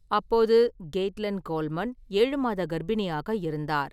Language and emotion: Tamil, neutral